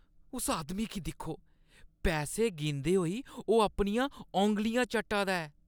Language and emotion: Dogri, disgusted